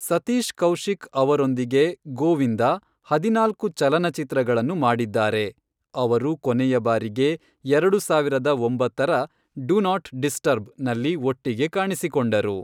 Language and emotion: Kannada, neutral